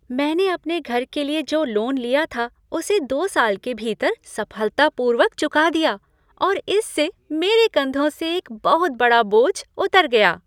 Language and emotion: Hindi, happy